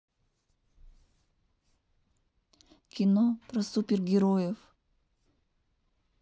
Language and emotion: Russian, neutral